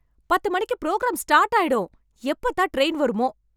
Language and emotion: Tamil, angry